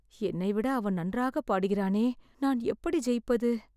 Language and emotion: Tamil, fearful